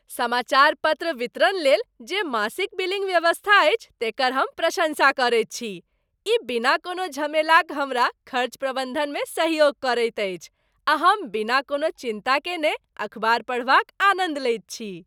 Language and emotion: Maithili, happy